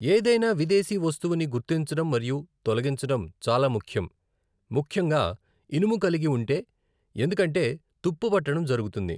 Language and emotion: Telugu, neutral